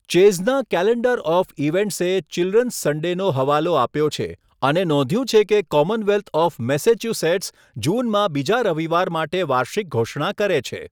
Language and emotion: Gujarati, neutral